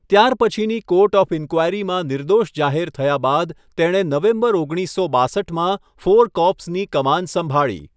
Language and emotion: Gujarati, neutral